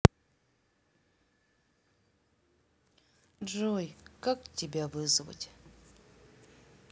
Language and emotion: Russian, sad